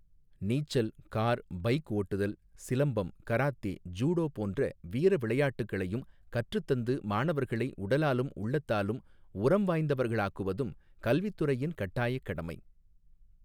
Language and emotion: Tamil, neutral